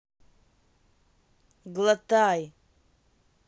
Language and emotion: Russian, neutral